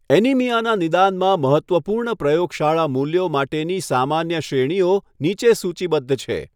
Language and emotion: Gujarati, neutral